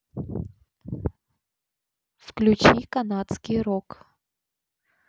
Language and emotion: Russian, neutral